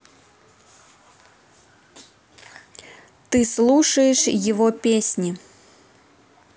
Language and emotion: Russian, neutral